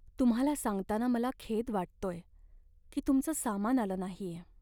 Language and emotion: Marathi, sad